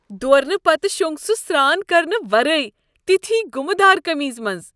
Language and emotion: Kashmiri, disgusted